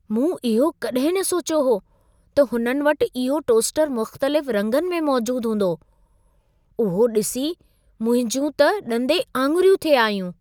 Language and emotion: Sindhi, surprised